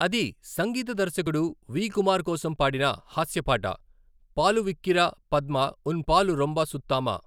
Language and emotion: Telugu, neutral